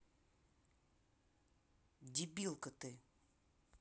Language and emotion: Russian, angry